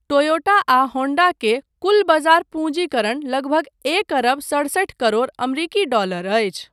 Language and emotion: Maithili, neutral